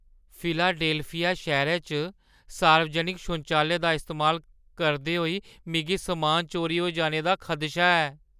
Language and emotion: Dogri, fearful